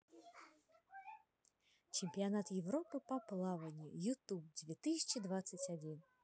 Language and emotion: Russian, positive